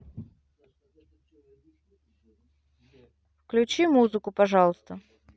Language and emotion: Russian, neutral